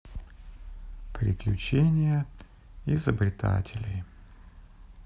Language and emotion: Russian, sad